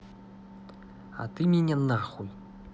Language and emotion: Russian, angry